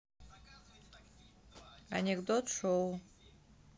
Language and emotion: Russian, neutral